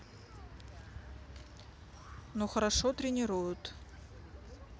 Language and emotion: Russian, neutral